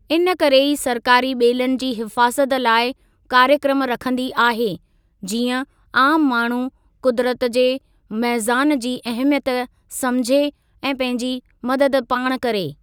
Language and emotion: Sindhi, neutral